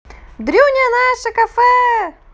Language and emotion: Russian, positive